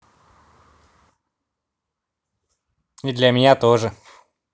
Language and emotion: Russian, neutral